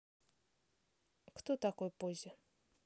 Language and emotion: Russian, neutral